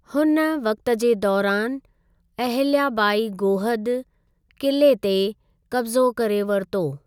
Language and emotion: Sindhi, neutral